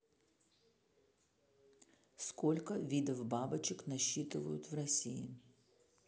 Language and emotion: Russian, neutral